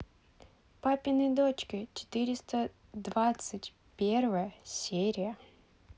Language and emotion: Russian, neutral